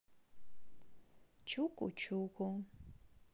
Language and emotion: Russian, neutral